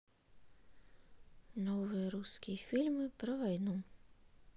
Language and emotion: Russian, sad